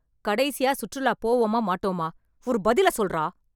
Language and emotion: Tamil, angry